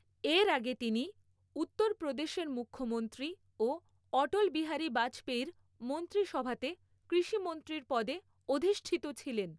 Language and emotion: Bengali, neutral